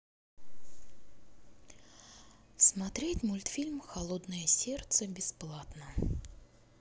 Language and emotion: Russian, neutral